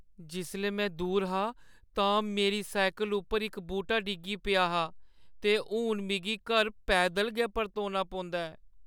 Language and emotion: Dogri, sad